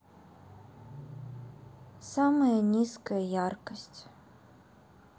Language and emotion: Russian, sad